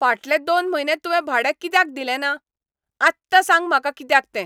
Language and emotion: Goan Konkani, angry